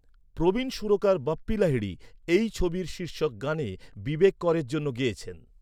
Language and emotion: Bengali, neutral